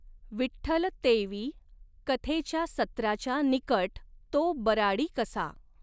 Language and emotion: Marathi, neutral